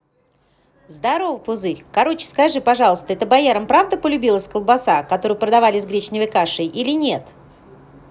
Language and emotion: Russian, positive